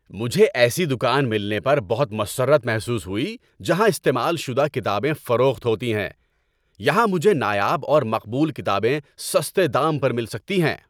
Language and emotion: Urdu, happy